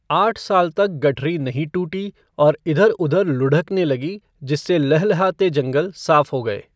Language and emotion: Hindi, neutral